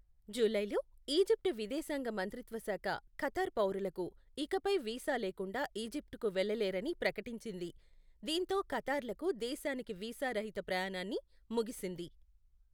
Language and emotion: Telugu, neutral